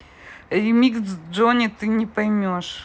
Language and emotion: Russian, neutral